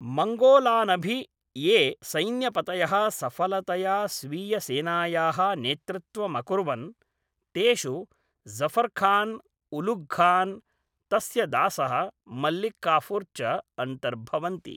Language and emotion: Sanskrit, neutral